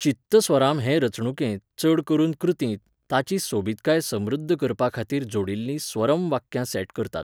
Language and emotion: Goan Konkani, neutral